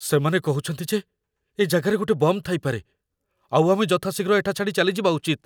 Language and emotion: Odia, fearful